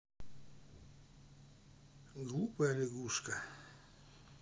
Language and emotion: Russian, sad